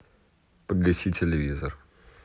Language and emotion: Russian, neutral